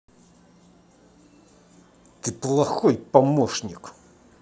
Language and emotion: Russian, angry